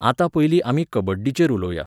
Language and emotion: Goan Konkani, neutral